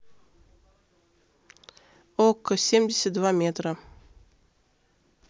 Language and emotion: Russian, neutral